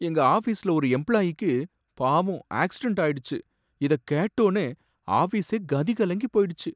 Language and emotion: Tamil, sad